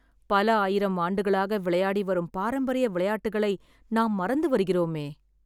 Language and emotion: Tamil, sad